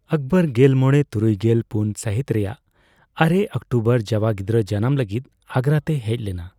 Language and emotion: Santali, neutral